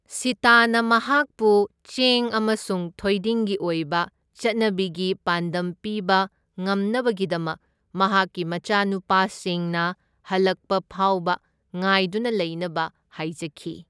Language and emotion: Manipuri, neutral